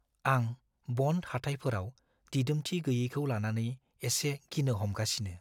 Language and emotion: Bodo, fearful